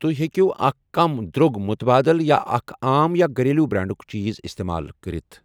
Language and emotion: Kashmiri, neutral